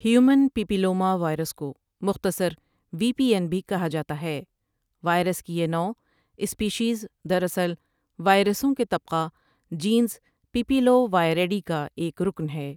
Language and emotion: Urdu, neutral